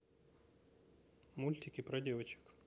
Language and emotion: Russian, neutral